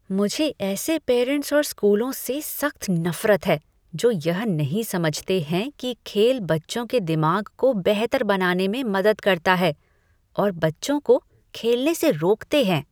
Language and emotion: Hindi, disgusted